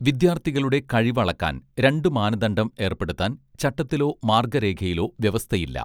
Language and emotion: Malayalam, neutral